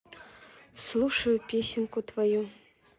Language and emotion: Russian, neutral